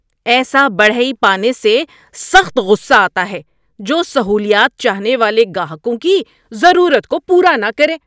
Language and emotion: Urdu, angry